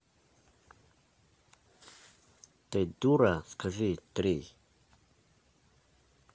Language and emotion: Russian, angry